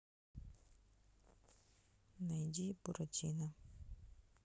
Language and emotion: Russian, sad